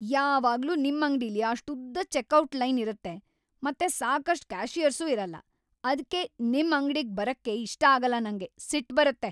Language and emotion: Kannada, angry